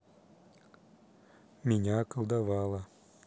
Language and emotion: Russian, neutral